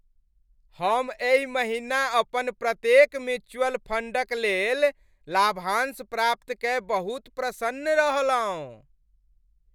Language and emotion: Maithili, happy